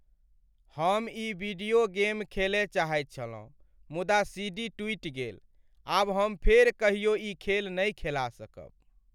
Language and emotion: Maithili, sad